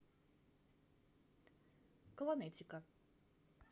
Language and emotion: Russian, neutral